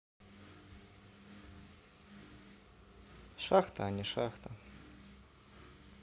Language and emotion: Russian, neutral